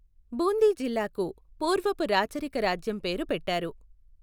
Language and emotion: Telugu, neutral